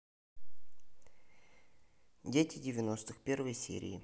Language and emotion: Russian, neutral